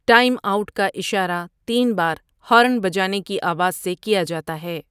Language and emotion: Urdu, neutral